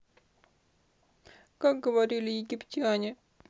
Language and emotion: Russian, sad